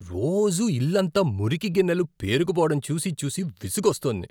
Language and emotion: Telugu, disgusted